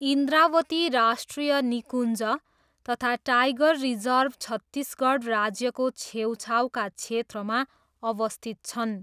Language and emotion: Nepali, neutral